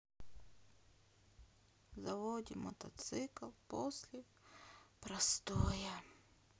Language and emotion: Russian, sad